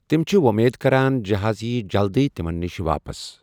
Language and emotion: Kashmiri, neutral